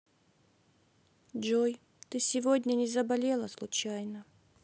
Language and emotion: Russian, sad